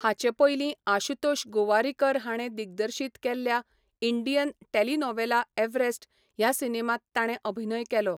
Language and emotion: Goan Konkani, neutral